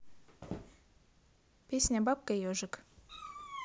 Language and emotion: Russian, neutral